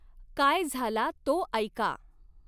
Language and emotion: Marathi, neutral